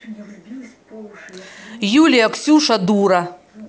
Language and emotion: Russian, angry